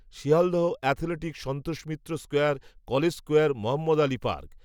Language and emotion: Bengali, neutral